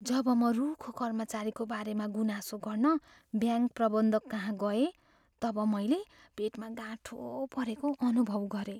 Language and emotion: Nepali, fearful